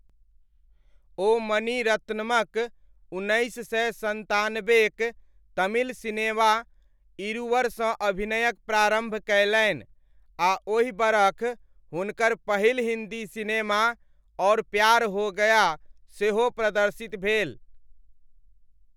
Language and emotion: Maithili, neutral